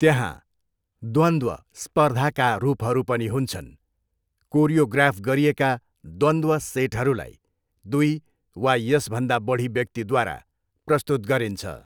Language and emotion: Nepali, neutral